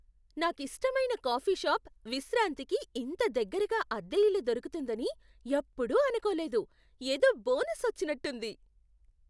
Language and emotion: Telugu, surprised